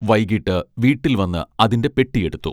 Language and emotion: Malayalam, neutral